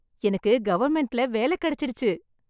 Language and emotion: Tamil, happy